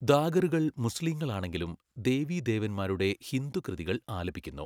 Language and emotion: Malayalam, neutral